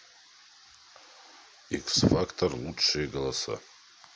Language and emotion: Russian, neutral